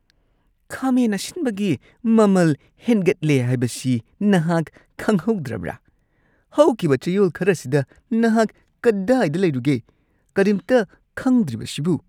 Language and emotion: Manipuri, disgusted